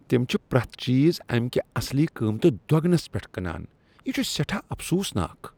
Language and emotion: Kashmiri, disgusted